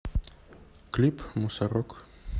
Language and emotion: Russian, neutral